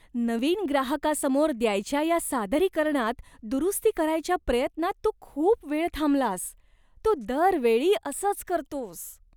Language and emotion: Marathi, disgusted